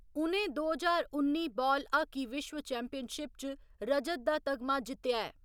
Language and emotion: Dogri, neutral